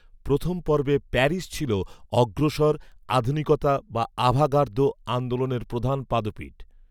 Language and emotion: Bengali, neutral